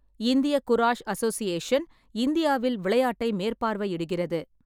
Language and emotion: Tamil, neutral